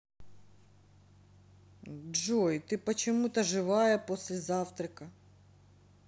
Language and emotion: Russian, neutral